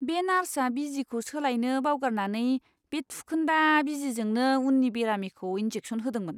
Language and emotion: Bodo, disgusted